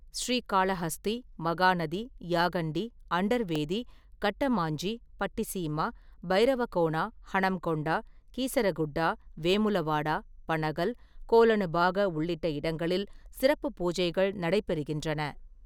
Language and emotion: Tamil, neutral